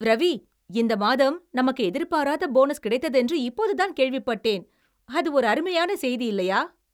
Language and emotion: Tamil, happy